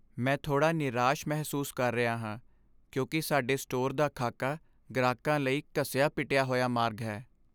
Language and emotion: Punjabi, sad